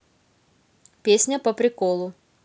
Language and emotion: Russian, positive